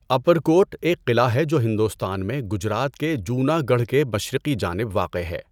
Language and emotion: Urdu, neutral